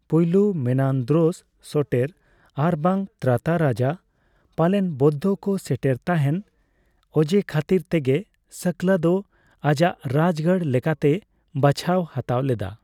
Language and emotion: Santali, neutral